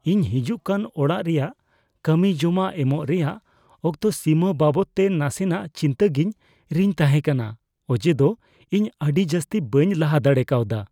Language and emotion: Santali, fearful